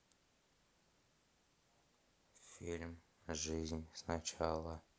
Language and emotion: Russian, neutral